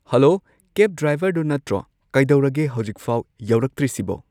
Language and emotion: Manipuri, neutral